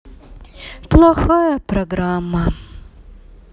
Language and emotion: Russian, sad